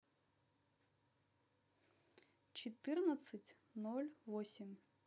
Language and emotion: Russian, neutral